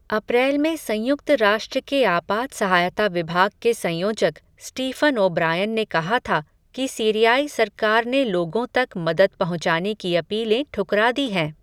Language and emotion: Hindi, neutral